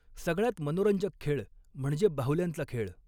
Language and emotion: Marathi, neutral